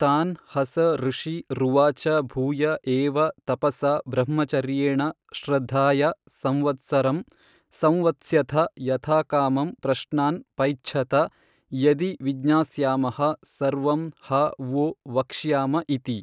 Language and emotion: Kannada, neutral